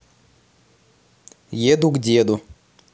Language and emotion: Russian, neutral